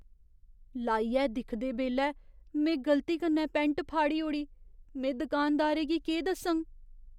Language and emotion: Dogri, fearful